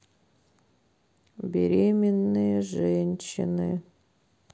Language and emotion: Russian, sad